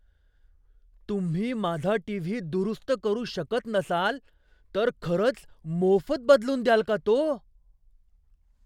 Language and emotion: Marathi, surprised